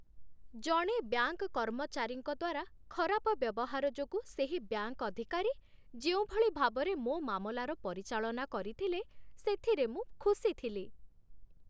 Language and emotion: Odia, happy